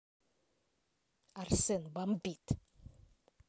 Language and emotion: Russian, angry